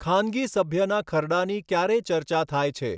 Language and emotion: Gujarati, neutral